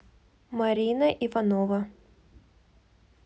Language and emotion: Russian, neutral